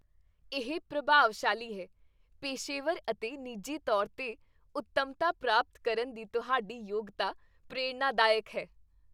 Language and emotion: Punjabi, happy